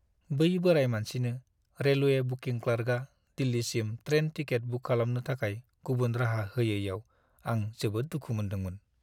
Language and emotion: Bodo, sad